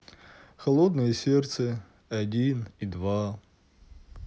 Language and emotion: Russian, sad